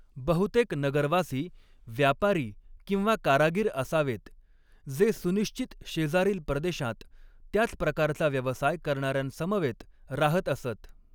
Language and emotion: Marathi, neutral